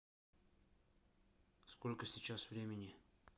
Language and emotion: Russian, neutral